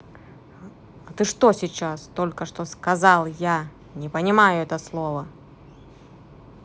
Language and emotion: Russian, angry